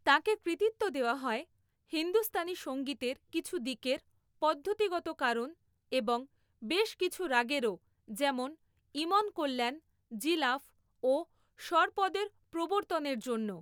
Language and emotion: Bengali, neutral